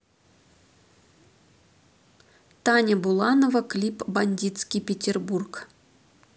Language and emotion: Russian, neutral